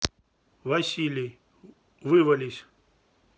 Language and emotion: Russian, neutral